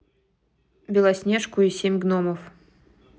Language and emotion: Russian, neutral